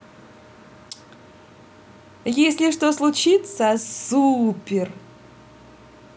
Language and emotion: Russian, positive